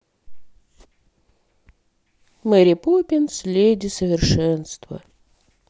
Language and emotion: Russian, sad